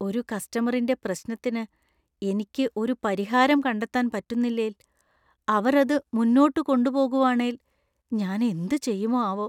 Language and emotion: Malayalam, fearful